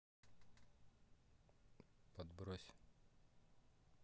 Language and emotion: Russian, neutral